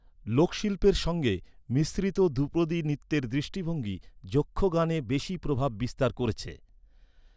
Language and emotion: Bengali, neutral